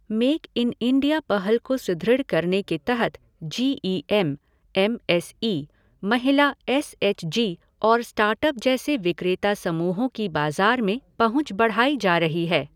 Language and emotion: Hindi, neutral